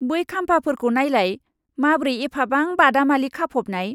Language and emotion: Bodo, disgusted